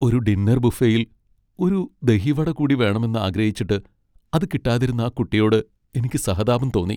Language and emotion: Malayalam, sad